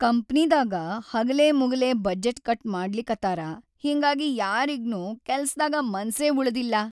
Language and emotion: Kannada, sad